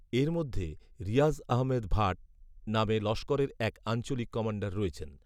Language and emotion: Bengali, neutral